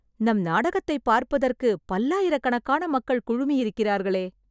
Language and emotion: Tamil, surprised